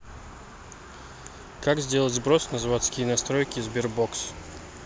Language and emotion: Russian, neutral